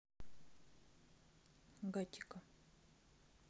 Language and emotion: Russian, neutral